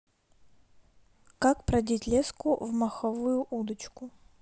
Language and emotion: Russian, neutral